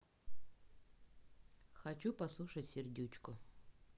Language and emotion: Russian, neutral